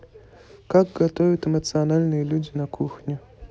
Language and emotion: Russian, neutral